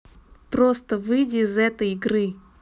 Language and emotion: Russian, angry